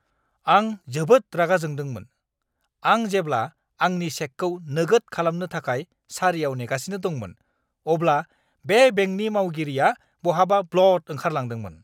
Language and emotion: Bodo, angry